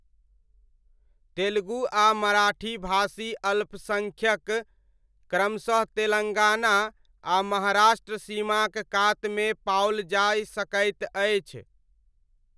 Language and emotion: Maithili, neutral